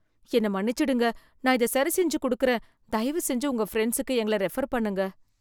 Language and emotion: Tamil, fearful